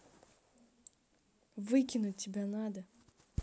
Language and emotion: Russian, angry